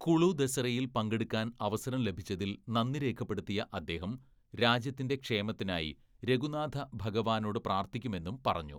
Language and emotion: Malayalam, neutral